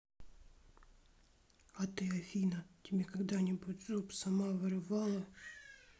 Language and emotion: Russian, sad